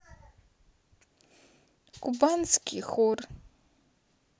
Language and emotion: Russian, sad